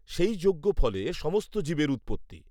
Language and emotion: Bengali, neutral